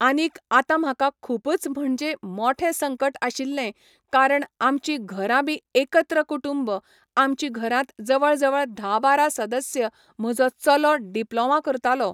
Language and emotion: Goan Konkani, neutral